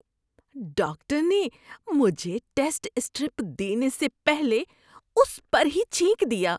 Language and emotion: Urdu, disgusted